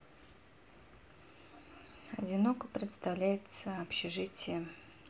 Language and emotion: Russian, sad